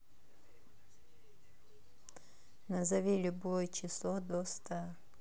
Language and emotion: Russian, neutral